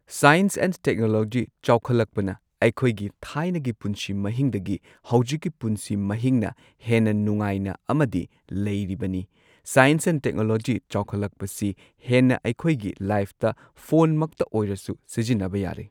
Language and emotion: Manipuri, neutral